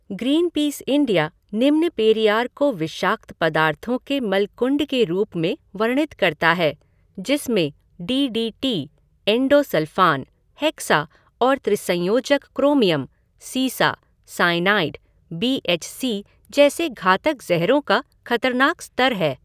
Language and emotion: Hindi, neutral